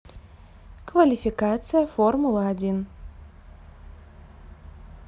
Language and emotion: Russian, neutral